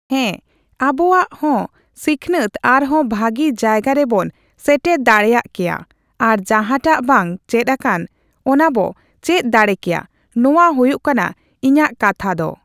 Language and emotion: Santali, neutral